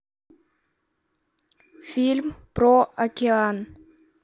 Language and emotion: Russian, neutral